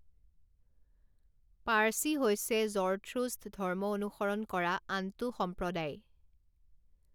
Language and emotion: Assamese, neutral